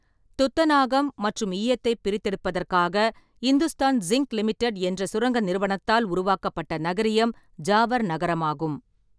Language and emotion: Tamil, neutral